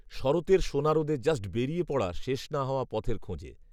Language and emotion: Bengali, neutral